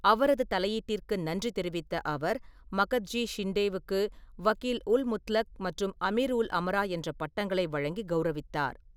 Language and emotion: Tamil, neutral